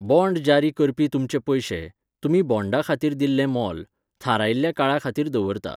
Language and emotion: Goan Konkani, neutral